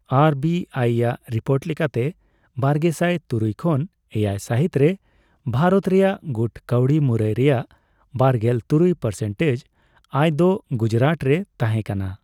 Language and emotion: Santali, neutral